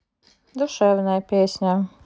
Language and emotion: Russian, neutral